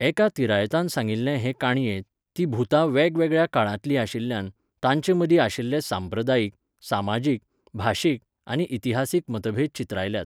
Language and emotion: Goan Konkani, neutral